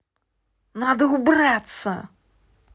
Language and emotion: Russian, angry